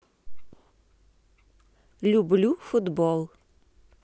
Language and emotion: Russian, positive